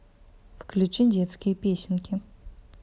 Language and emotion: Russian, neutral